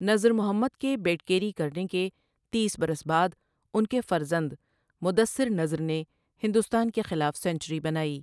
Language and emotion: Urdu, neutral